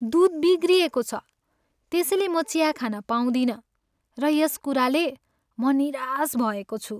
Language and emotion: Nepali, sad